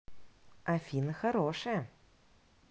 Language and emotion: Russian, positive